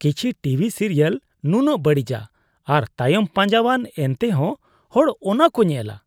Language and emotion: Santali, disgusted